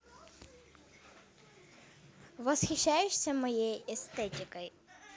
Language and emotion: Russian, positive